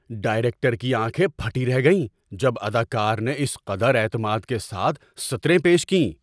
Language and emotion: Urdu, surprised